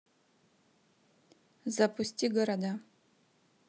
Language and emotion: Russian, neutral